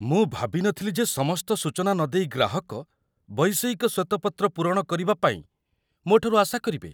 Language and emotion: Odia, surprised